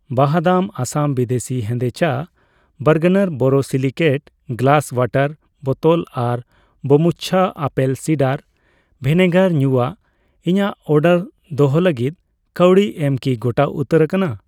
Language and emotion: Santali, neutral